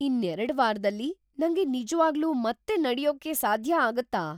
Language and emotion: Kannada, surprised